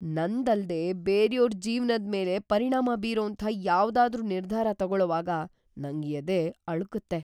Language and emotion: Kannada, fearful